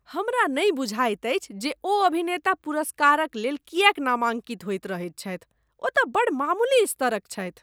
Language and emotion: Maithili, disgusted